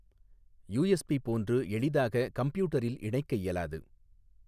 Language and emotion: Tamil, neutral